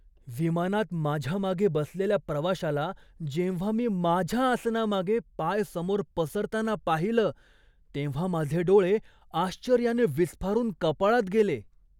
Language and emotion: Marathi, surprised